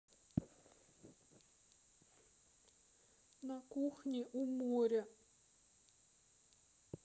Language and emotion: Russian, sad